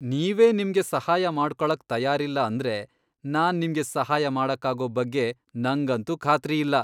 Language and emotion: Kannada, disgusted